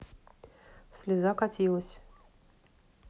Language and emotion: Russian, neutral